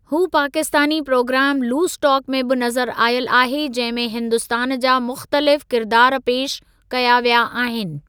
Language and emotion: Sindhi, neutral